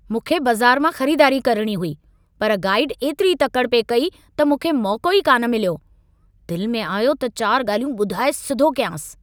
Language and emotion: Sindhi, angry